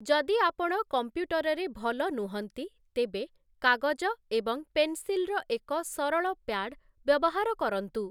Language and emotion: Odia, neutral